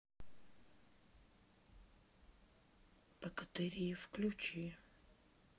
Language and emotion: Russian, neutral